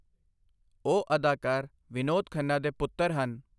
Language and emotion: Punjabi, neutral